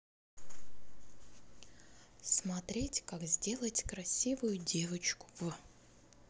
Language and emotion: Russian, neutral